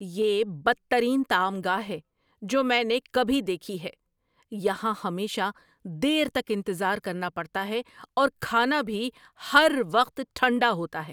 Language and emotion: Urdu, angry